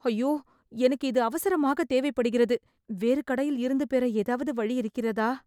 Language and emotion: Tamil, sad